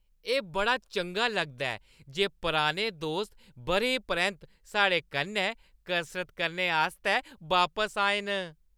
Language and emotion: Dogri, happy